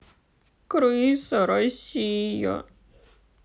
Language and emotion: Russian, sad